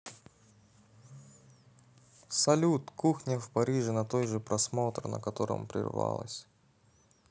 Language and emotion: Russian, neutral